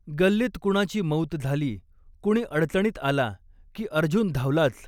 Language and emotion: Marathi, neutral